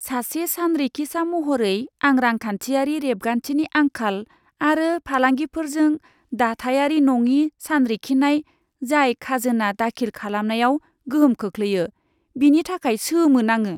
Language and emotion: Bodo, disgusted